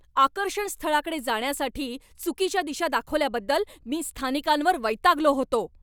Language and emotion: Marathi, angry